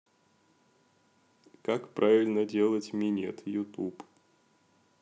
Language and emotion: Russian, neutral